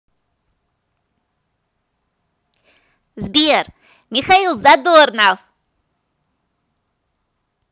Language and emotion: Russian, positive